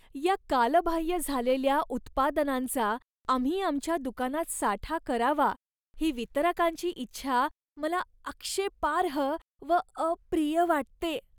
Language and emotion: Marathi, disgusted